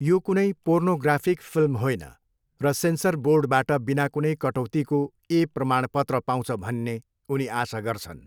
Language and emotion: Nepali, neutral